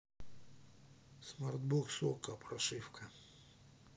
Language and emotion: Russian, neutral